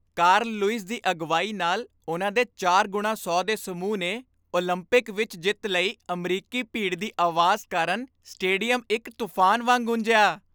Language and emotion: Punjabi, happy